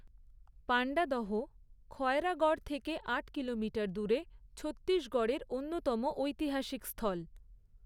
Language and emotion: Bengali, neutral